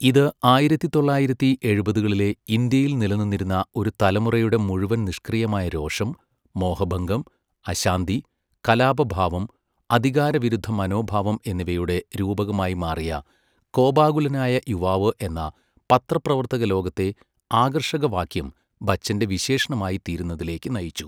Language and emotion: Malayalam, neutral